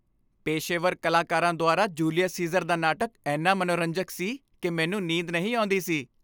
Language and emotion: Punjabi, happy